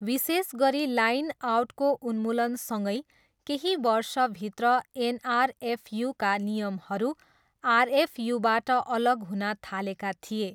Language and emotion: Nepali, neutral